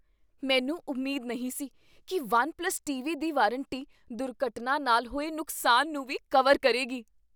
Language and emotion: Punjabi, surprised